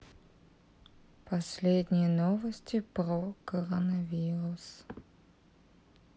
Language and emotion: Russian, sad